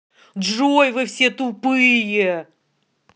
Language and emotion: Russian, angry